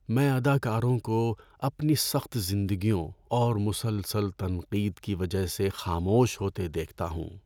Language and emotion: Urdu, sad